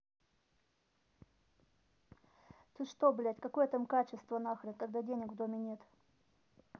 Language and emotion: Russian, angry